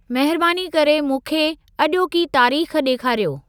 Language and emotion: Sindhi, neutral